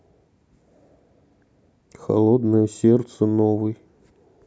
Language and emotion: Russian, neutral